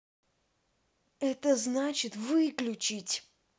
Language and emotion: Russian, angry